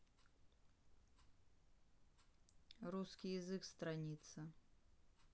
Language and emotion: Russian, neutral